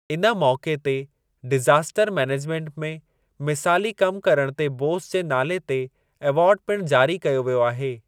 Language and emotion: Sindhi, neutral